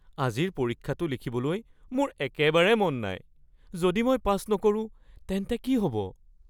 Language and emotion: Assamese, fearful